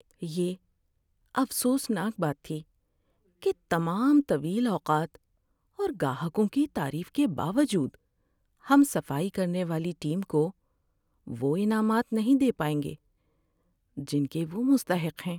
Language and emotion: Urdu, sad